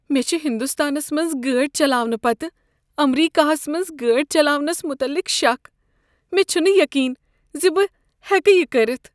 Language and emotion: Kashmiri, fearful